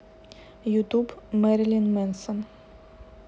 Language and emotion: Russian, neutral